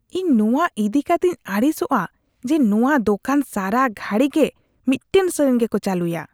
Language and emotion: Santali, disgusted